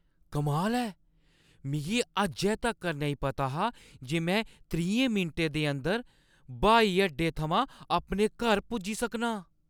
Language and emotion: Dogri, surprised